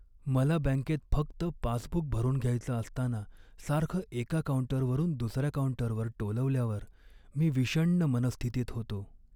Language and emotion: Marathi, sad